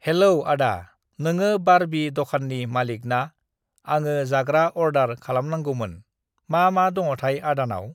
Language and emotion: Bodo, neutral